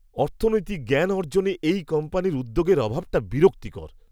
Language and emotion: Bengali, disgusted